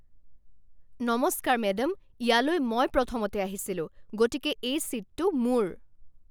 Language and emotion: Assamese, angry